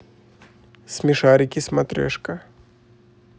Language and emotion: Russian, neutral